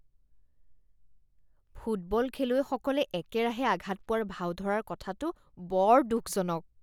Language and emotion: Assamese, disgusted